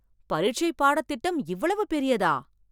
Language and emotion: Tamil, surprised